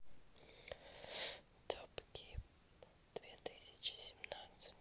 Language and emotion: Russian, neutral